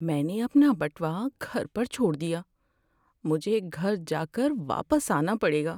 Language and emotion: Urdu, sad